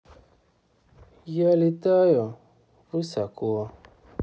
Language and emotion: Russian, sad